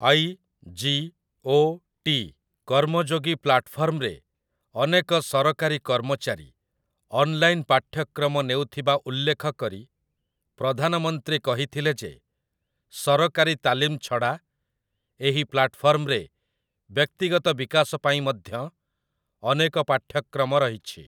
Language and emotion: Odia, neutral